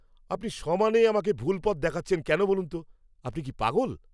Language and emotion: Bengali, angry